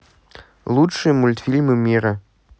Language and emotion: Russian, neutral